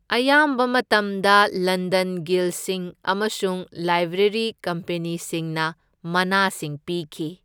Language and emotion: Manipuri, neutral